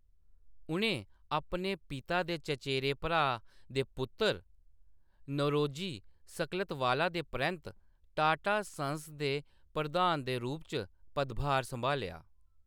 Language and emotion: Dogri, neutral